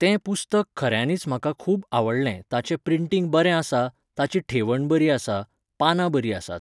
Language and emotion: Goan Konkani, neutral